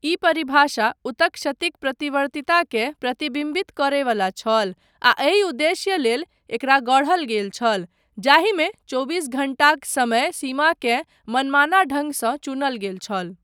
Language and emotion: Maithili, neutral